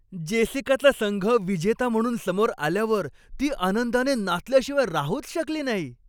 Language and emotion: Marathi, happy